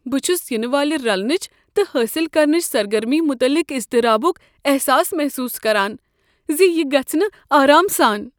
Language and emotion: Kashmiri, fearful